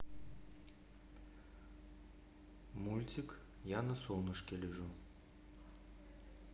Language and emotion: Russian, neutral